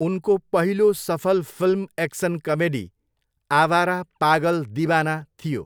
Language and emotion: Nepali, neutral